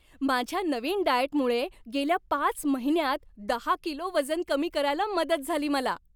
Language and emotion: Marathi, happy